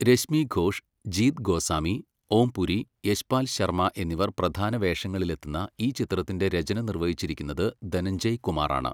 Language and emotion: Malayalam, neutral